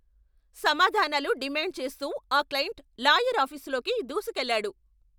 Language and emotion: Telugu, angry